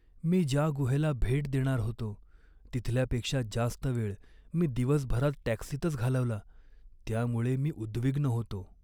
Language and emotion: Marathi, sad